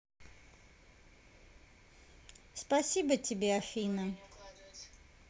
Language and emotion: Russian, positive